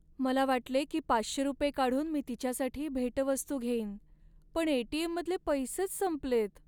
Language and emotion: Marathi, sad